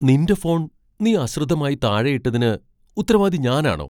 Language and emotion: Malayalam, surprised